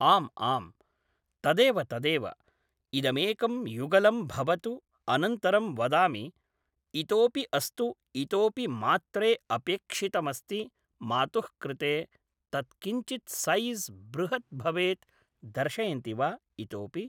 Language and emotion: Sanskrit, neutral